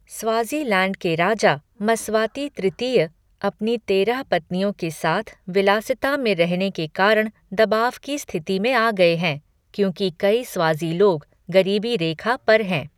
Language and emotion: Hindi, neutral